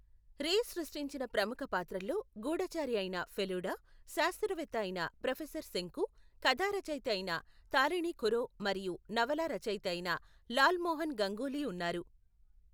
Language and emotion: Telugu, neutral